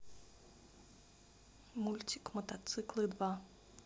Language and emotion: Russian, neutral